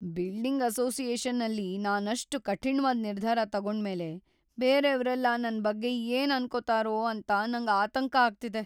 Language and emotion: Kannada, fearful